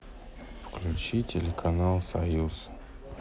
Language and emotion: Russian, sad